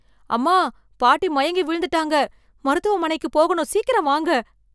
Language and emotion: Tamil, fearful